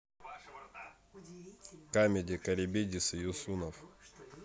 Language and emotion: Russian, neutral